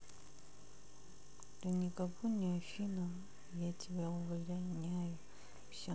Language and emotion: Russian, sad